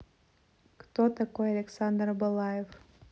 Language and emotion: Russian, neutral